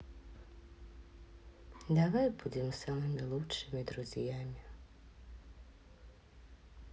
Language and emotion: Russian, sad